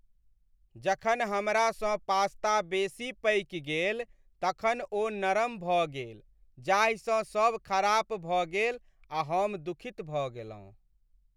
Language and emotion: Maithili, sad